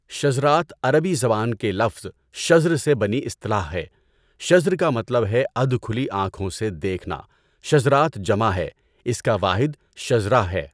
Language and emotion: Urdu, neutral